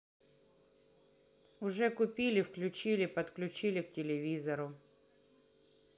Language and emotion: Russian, neutral